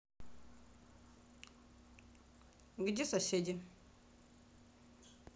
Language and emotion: Russian, neutral